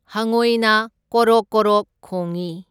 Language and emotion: Manipuri, neutral